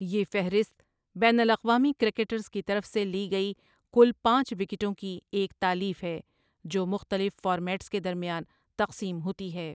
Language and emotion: Urdu, neutral